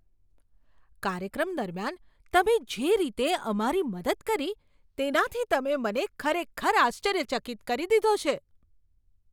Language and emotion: Gujarati, surprised